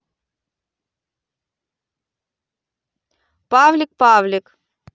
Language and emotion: Russian, positive